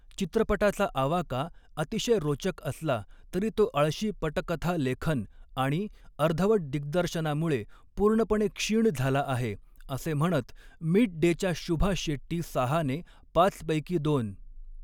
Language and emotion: Marathi, neutral